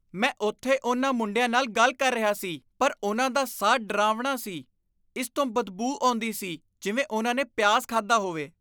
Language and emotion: Punjabi, disgusted